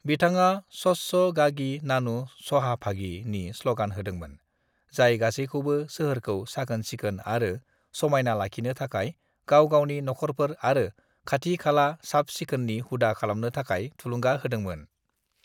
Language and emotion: Bodo, neutral